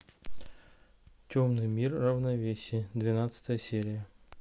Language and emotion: Russian, neutral